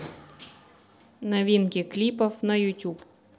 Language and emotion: Russian, positive